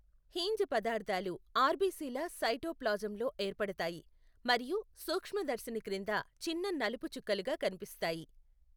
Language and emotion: Telugu, neutral